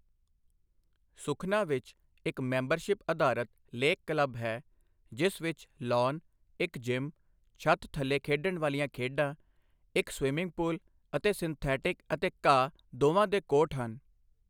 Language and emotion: Punjabi, neutral